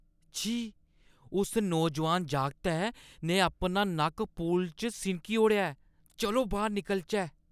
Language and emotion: Dogri, disgusted